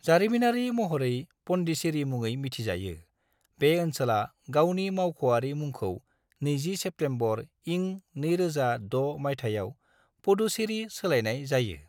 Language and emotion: Bodo, neutral